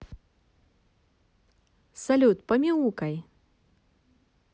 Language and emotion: Russian, positive